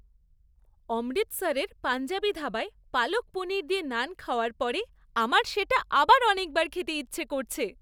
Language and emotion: Bengali, happy